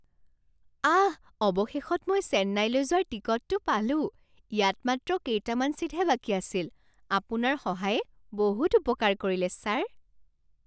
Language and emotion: Assamese, surprised